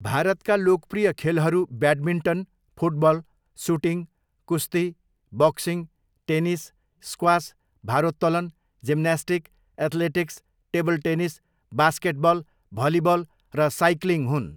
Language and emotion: Nepali, neutral